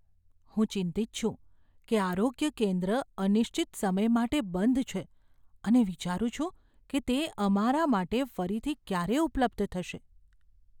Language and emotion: Gujarati, fearful